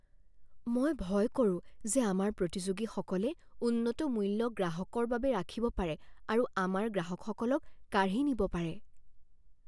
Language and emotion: Assamese, fearful